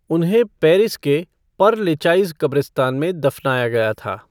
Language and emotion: Hindi, neutral